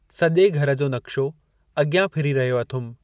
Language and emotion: Sindhi, neutral